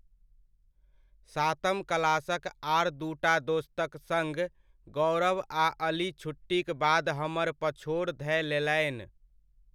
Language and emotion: Maithili, neutral